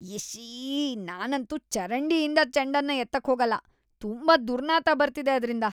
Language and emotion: Kannada, disgusted